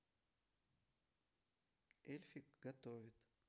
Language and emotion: Russian, neutral